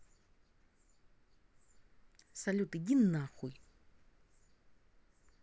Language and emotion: Russian, angry